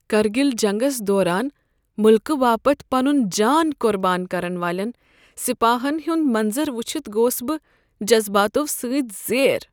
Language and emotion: Kashmiri, sad